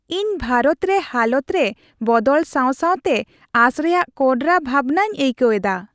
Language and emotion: Santali, happy